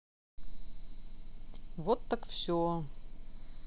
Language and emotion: Russian, neutral